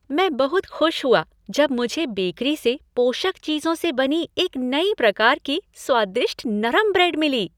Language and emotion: Hindi, happy